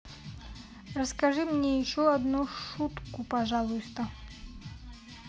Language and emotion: Russian, neutral